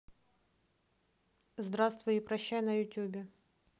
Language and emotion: Russian, neutral